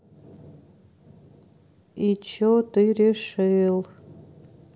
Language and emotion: Russian, sad